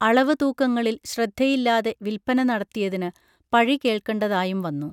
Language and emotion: Malayalam, neutral